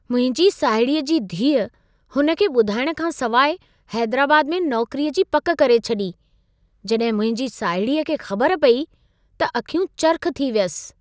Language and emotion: Sindhi, surprised